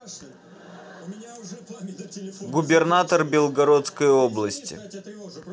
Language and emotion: Russian, neutral